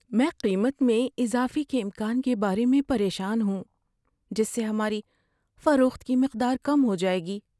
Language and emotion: Urdu, fearful